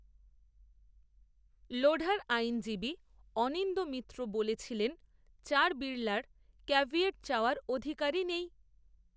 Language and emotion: Bengali, neutral